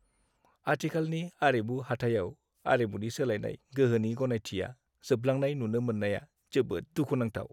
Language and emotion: Bodo, sad